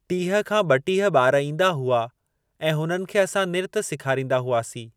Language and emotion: Sindhi, neutral